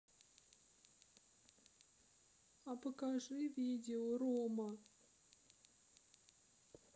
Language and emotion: Russian, sad